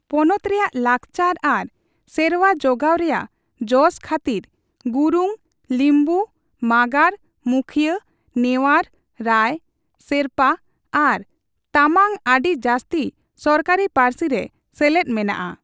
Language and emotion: Santali, neutral